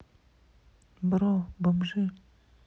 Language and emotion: Russian, neutral